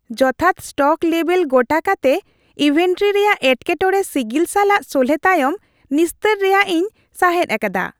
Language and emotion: Santali, happy